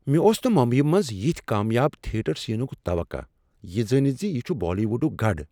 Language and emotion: Kashmiri, surprised